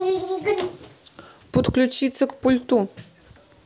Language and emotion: Russian, neutral